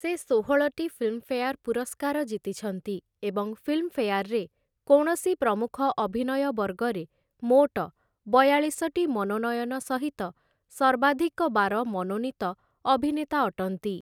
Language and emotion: Odia, neutral